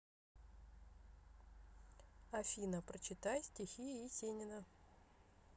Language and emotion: Russian, neutral